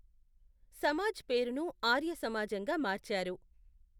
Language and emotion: Telugu, neutral